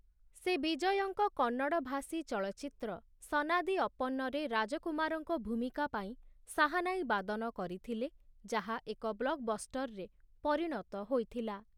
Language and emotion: Odia, neutral